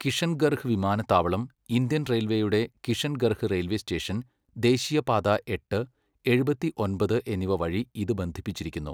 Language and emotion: Malayalam, neutral